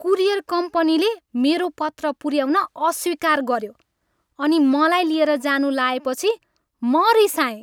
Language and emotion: Nepali, angry